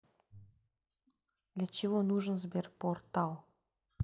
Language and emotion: Russian, neutral